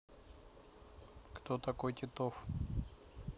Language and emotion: Russian, neutral